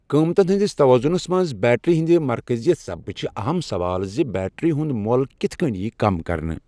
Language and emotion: Kashmiri, neutral